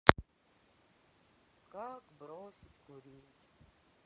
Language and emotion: Russian, sad